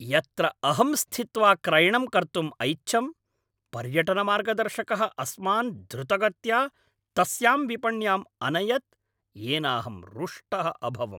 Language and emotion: Sanskrit, angry